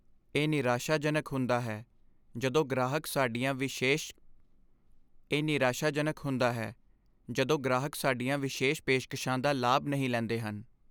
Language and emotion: Punjabi, sad